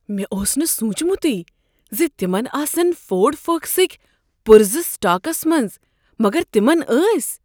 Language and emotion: Kashmiri, surprised